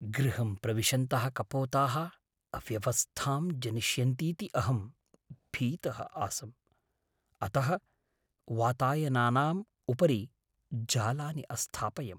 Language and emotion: Sanskrit, fearful